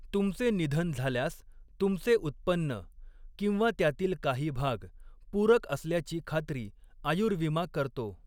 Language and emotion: Marathi, neutral